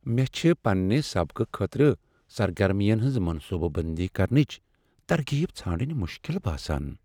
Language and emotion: Kashmiri, sad